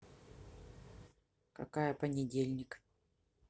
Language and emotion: Russian, neutral